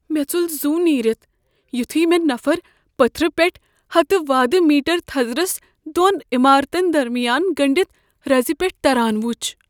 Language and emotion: Kashmiri, fearful